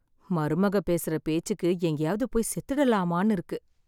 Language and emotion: Tamil, sad